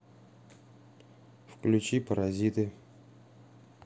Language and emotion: Russian, neutral